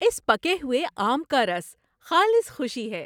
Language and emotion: Urdu, happy